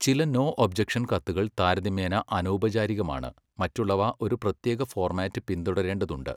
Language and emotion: Malayalam, neutral